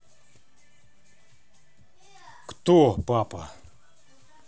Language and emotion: Russian, neutral